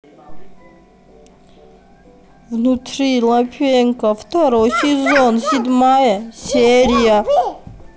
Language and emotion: Russian, neutral